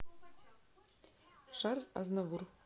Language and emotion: Russian, neutral